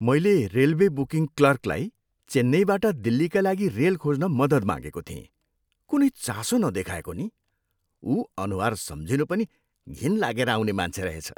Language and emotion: Nepali, disgusted